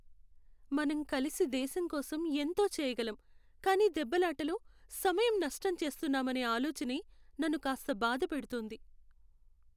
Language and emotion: Telugu, sad